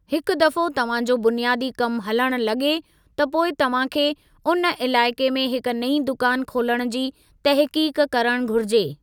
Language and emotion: Sindhi, neutral